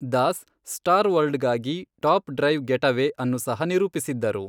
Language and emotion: Kannada, neutral